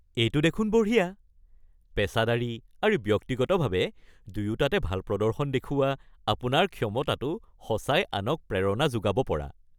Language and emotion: Assamese, happy